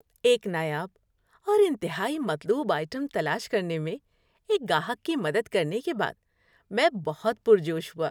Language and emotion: Urdu, happy